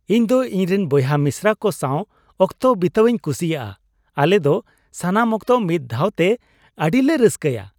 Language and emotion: Santali, happy